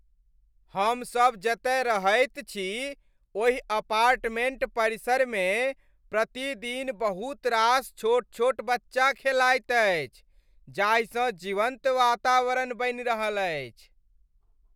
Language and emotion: Maithili, happy